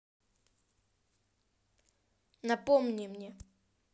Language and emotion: Russian, angry